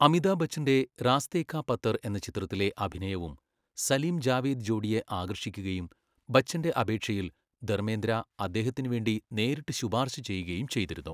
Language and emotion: Malayalam, neutral